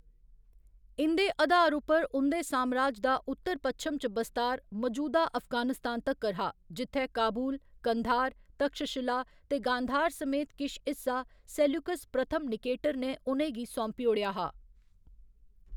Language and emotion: Dogri, neutral